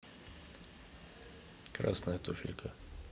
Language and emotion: Russian, neutral